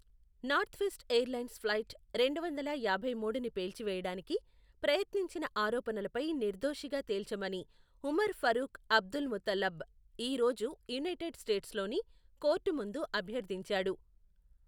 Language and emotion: Telugu, neutral